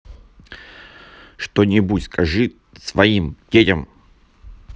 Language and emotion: Russian, angry